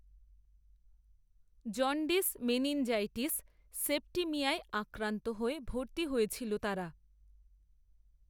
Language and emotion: Bengali, neutral